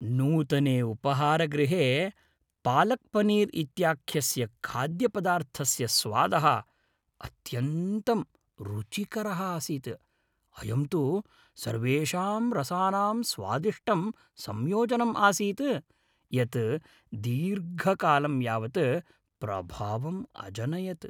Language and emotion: Sanskrit, happy